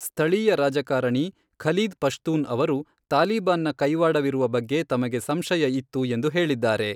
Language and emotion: Kannada, neutral